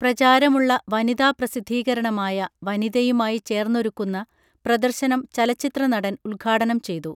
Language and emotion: Malayalam, neutral